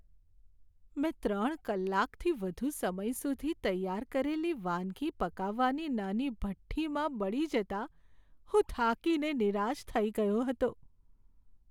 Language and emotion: Gujarati, sad